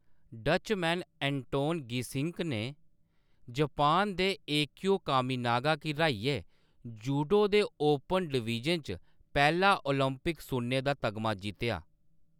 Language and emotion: Dogri, neutral